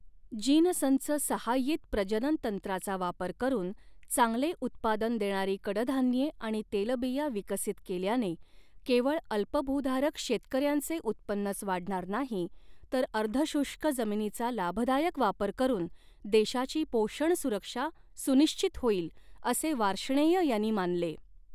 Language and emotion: Marathi, neutral